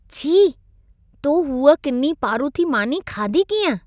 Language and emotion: Sindhi, disgusted